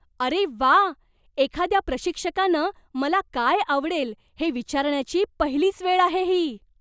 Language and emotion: Marathi, surprised